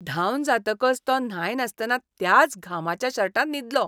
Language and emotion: Goan Konkani, disgusted